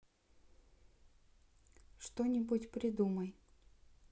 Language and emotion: Russian, neutral